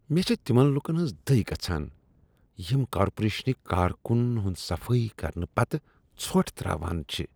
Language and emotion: Kashmiri, disgusted